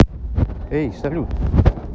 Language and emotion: Russian, neutral